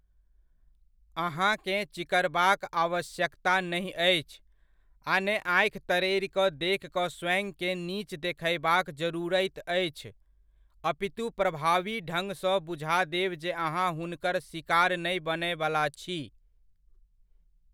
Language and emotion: Maithili, neutral